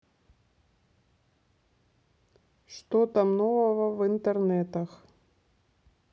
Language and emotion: Russian, neutral